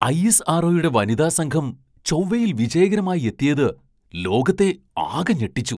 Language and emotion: Malayalam, surprised